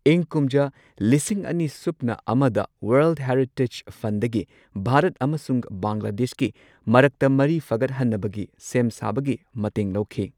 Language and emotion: Manipuri, neutral